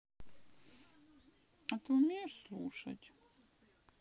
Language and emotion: Russian, sad